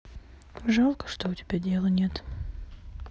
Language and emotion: Russian, sad